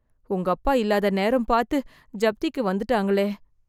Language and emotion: Tamil, fearful